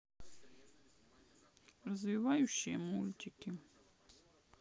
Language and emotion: Russian, sad